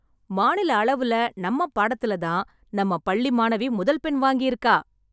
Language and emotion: Tamil, happy